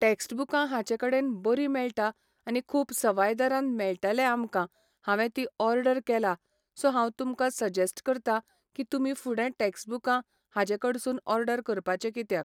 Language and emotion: Goan Konkani, neutral